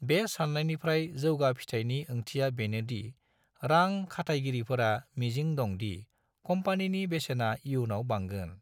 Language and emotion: Bodo, neutral